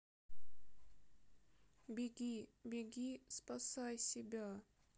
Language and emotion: Russian, sad